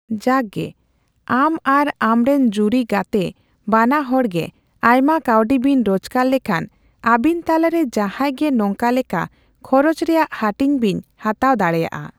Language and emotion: Santali, neutral